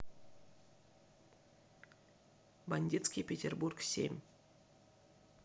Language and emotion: Russian, neutral